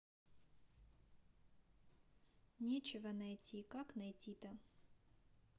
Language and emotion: Russian, sad